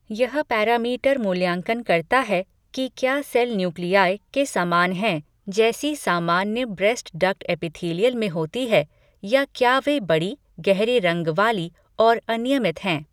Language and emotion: Hindi, neutral